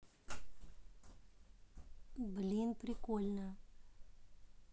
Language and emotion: Russian, neutral